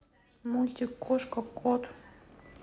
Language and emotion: Russian, neutral